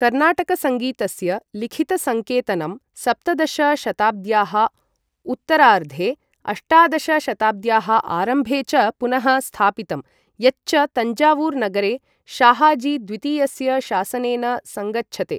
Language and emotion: Sanskrit, neutral